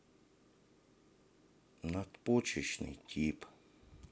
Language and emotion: Russian, sad